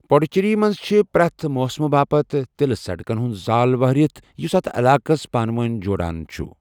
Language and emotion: Kashmiri, neutral